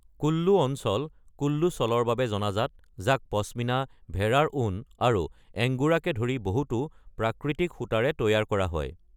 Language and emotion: Assamese, neutral